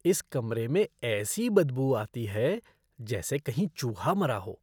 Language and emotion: Hindi, disgusted